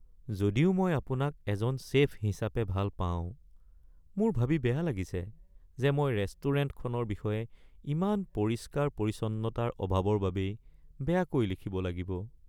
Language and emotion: Assamese, sad